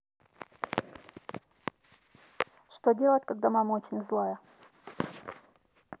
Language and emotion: Russian, neutral